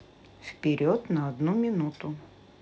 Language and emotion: Russian, neutral